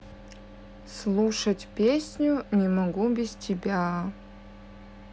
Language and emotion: Russian, neutral